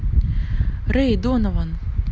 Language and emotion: Russian, neutral